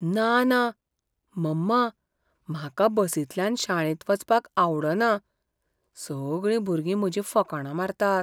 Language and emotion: Goan Konkani, fearful